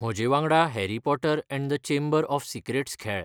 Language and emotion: Goan Konkani, neutral